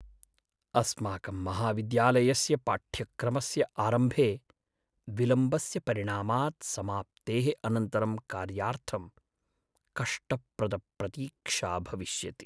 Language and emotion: Sanskrit, sad